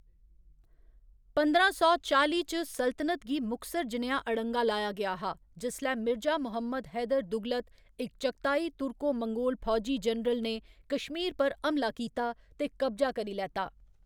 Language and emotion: Dogri, neutral